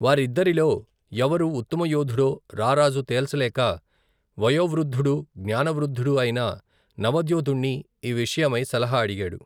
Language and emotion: Telugu, neutral